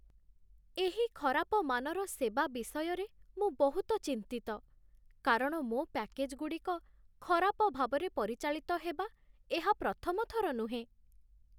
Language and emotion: Odia, sad